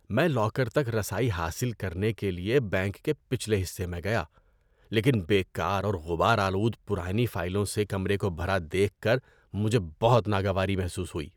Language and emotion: Urdu, disgusted